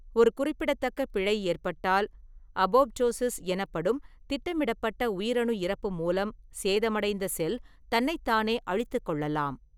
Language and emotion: Tamil, neutral